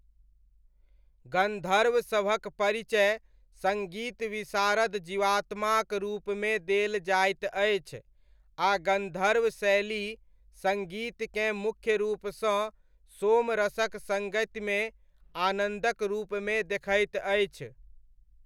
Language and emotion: Maithili, neutral